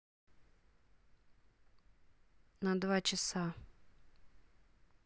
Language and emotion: Russian, neutral